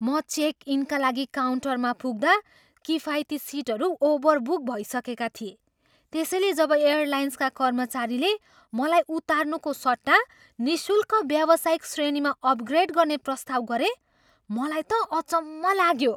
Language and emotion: Nepali, surprised